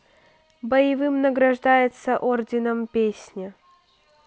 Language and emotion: Russian, neutral